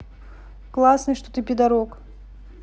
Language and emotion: Russian, neutral